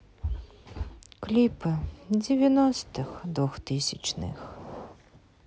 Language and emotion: Russian, sad